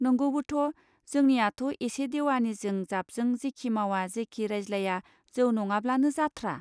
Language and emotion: Bodo, neutral